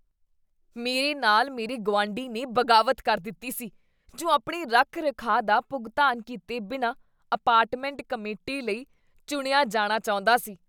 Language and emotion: Punjabi, disgusted